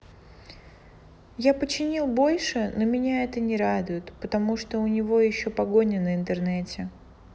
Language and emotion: Russian, sad